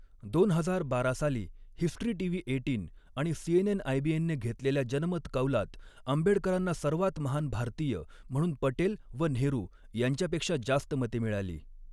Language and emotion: Marathi, neutral